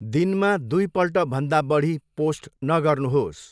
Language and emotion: Nepali, neutral